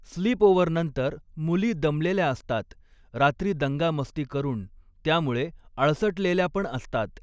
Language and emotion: Marathi, neutral